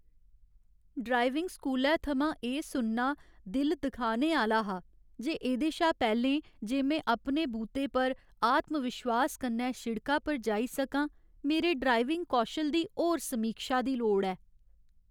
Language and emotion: Dogri, sad